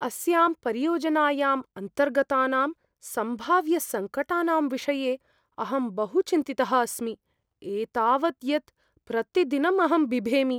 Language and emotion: Sanskrit, fearful